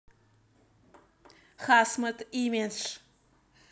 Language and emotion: Russian, neutral